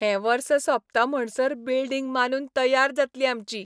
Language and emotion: Goan Konkani, happy